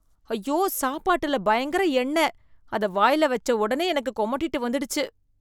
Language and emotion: Tamil, disgusted